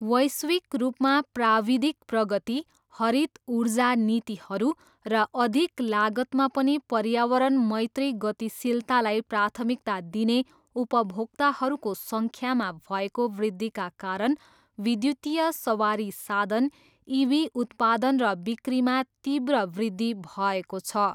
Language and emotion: Nepali, neutral